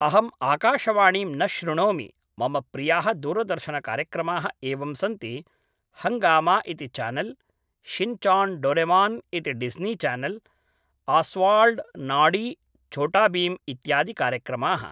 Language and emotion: Sanskrit, neutral